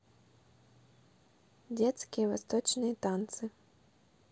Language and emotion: Russian, neutral